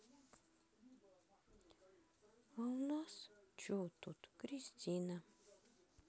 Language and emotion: Russian, neutral